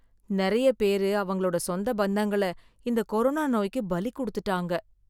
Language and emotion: Tamil, sad